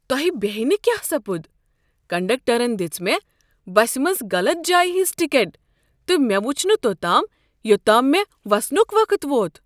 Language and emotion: Kashmiri, surprised